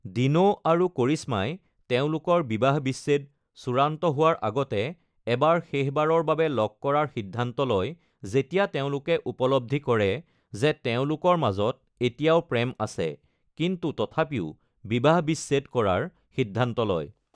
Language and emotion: Assamese, neutral